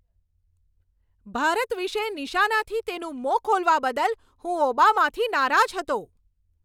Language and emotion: Gujarati, angry